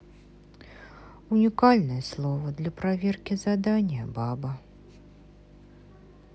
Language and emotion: Russian, sad